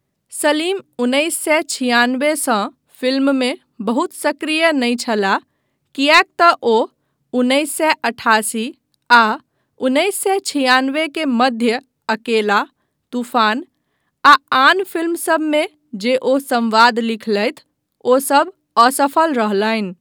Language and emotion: Maithili, neutral